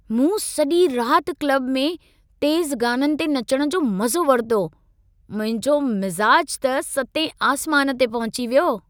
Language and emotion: Sindhi, happy